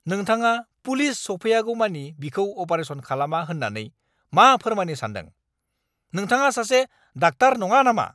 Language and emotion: Bodo, angry